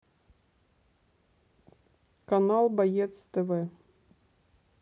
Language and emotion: Russian, neutral